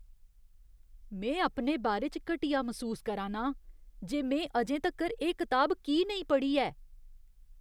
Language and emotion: Dogri, disgusted